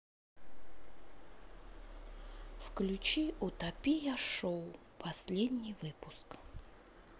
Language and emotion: Russian, sad